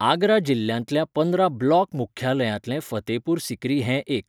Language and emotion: Goan Konkani, neutral